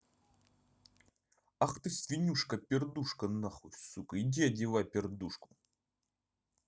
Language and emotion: Russian, angry